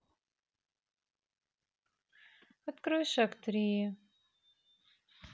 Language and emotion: Russian, sad